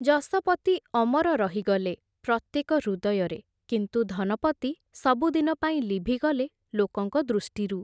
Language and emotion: Odia, neutral